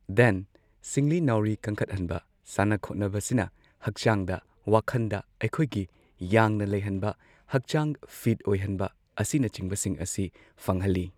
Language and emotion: Manipuri, neutral